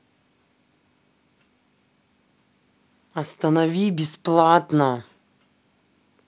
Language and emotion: Russian, angry